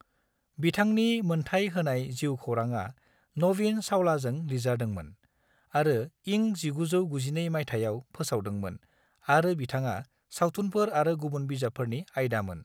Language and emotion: Bodo, neutral